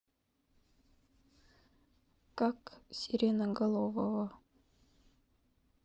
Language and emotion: Russian, neutral